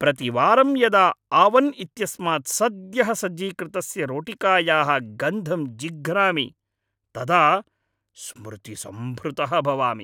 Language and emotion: Sanskrit, happy